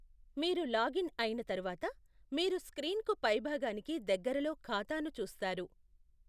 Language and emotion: Telugu, neutral